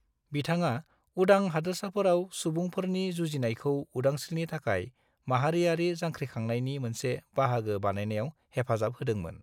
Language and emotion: Bodo, neutral